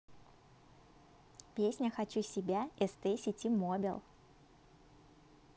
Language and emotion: Russian, positive